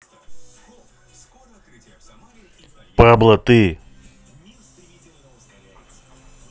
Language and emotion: Russian, angry